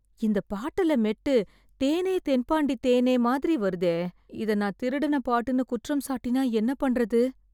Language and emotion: Tamil, fearful